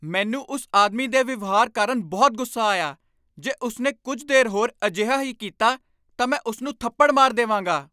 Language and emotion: Punjabi, angry